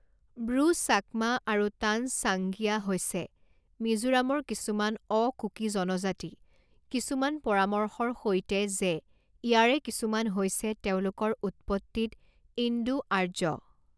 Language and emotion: Assamese, neutral